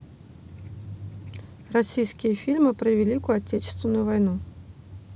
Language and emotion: Russian, neutral